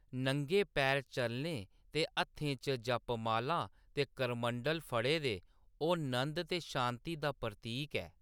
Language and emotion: Dogri, neutral